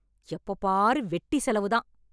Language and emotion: Tamil, angry